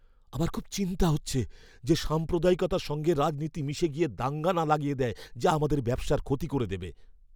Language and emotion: Bengali, fearful